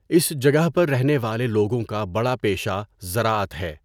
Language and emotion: Urdu, neutral